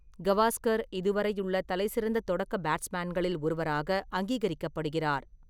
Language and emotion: Tamil, neutral